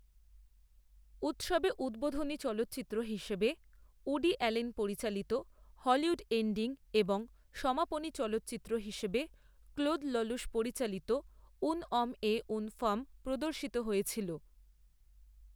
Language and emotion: Bengali, neutral